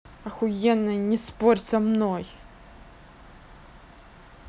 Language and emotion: Russian, angry